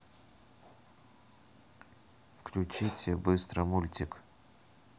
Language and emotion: Russian, neutral